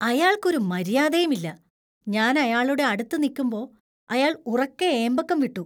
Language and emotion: Malayalam, disgusted